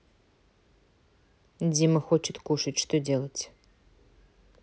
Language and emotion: Russian, neutral